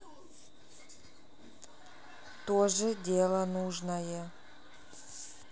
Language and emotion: Russian, neutral